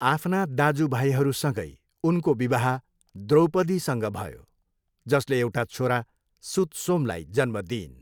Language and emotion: Nepali, neutral